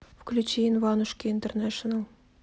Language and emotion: Russian, neutral